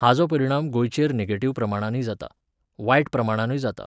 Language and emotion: Goan Konkani, neutral